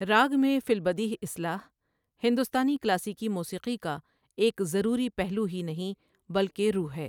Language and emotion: Urdu, neutral